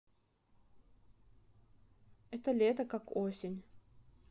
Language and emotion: Russian, sad